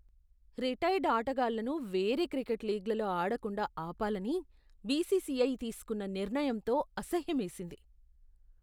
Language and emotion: Telugu, disgusted